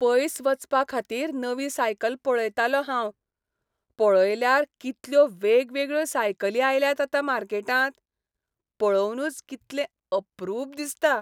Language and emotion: Goan Konkani, happy